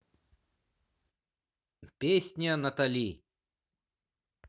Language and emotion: Russian, positive